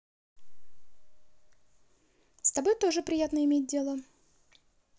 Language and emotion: Russian, positive